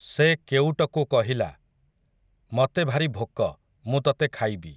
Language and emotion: Odia, neutral